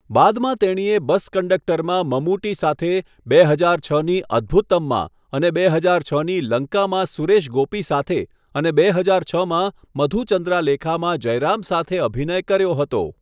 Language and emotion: Gujarati, neutral